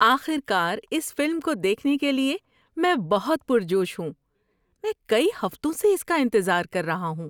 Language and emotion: Urdu, happy